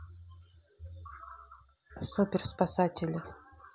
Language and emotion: Russian, neutral